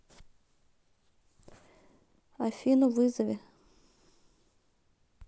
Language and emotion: Russian, neutral